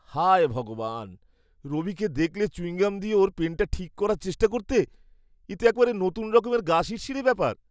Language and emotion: Bengali, disgusted